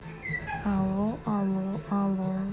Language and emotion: Russian, neutral